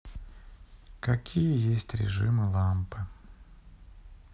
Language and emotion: Russian, sad